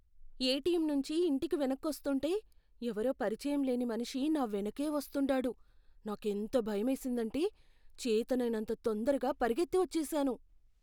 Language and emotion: Telugu, fearful